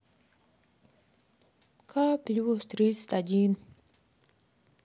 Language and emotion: Russian, sad